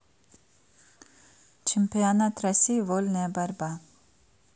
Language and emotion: Russian, neutral